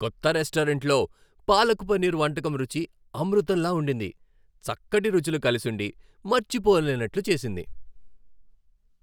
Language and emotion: Telugu, happy